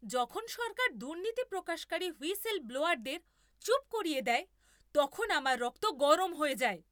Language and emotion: Bengali, angry